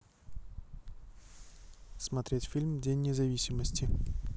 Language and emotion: Russian, neutral